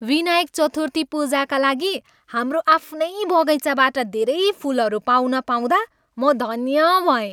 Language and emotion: Nepali, happy